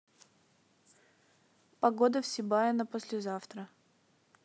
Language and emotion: Russian, neutral